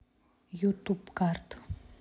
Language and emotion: Russian, neutral